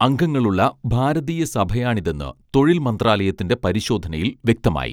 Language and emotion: Malayalam, neutral